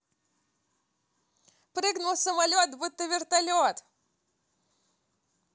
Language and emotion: Russian, positive